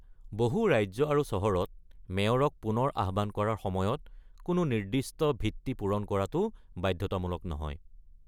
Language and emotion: Assamese, neutral